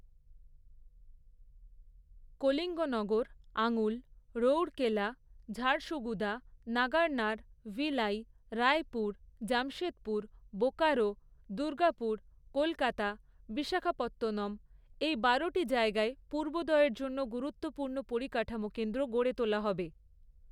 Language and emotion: Bengali, neutral